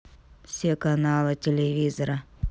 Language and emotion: Russian, neutral